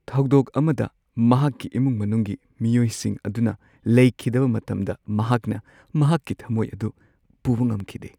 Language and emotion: Manipuri, sad